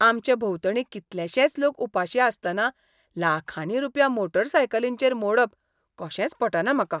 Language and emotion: Goan Konkani, disgusted